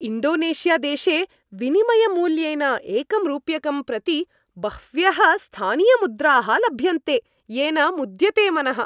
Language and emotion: Sanskrit, happy